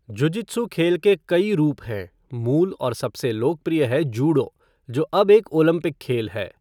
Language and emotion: Hindi, neutral